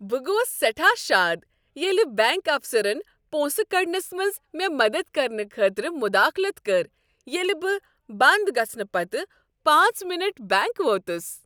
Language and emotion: Kashmiri, happy